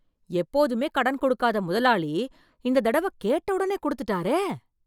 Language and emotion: Tamil, surprised